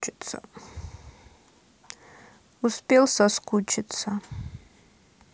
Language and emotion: Russian, sad